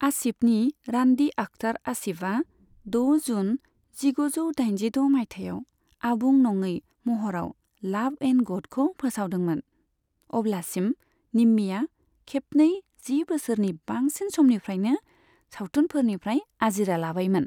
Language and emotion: Bodo, neutral